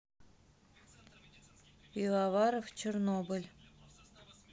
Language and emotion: Russian, neutral